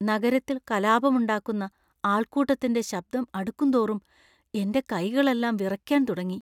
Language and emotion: Malayalam, fearful